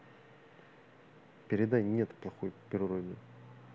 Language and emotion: Russian, neutral